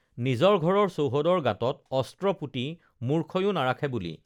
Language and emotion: Assamese, neutral